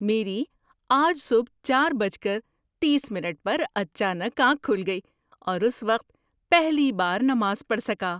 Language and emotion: Urdu, surprised